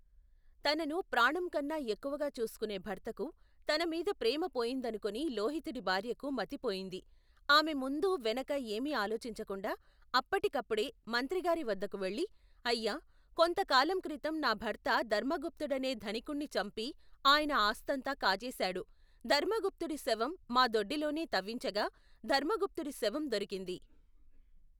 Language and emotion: Telugu, neutral